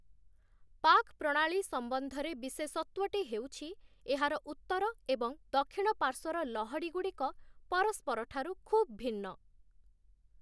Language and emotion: Odia, neutral